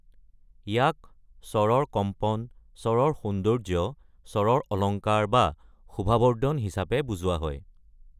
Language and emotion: Assamese, neutral